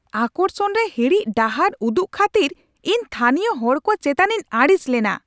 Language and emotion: Santali, angry